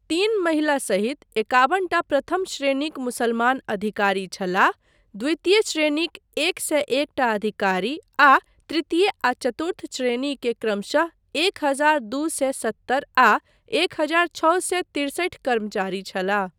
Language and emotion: Maithili, neutral